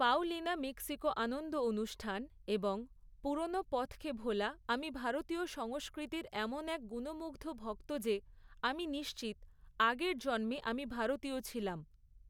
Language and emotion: Bengali, neutral